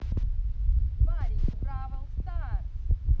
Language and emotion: Russian, positive